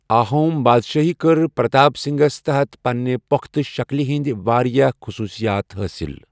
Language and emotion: Kashmiri, neutral